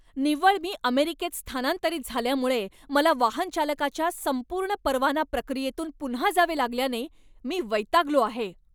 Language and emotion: Marathi, angry